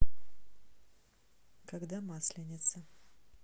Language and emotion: Russian, neutral